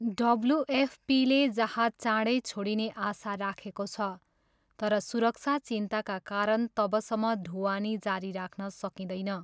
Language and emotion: Nepali, neutral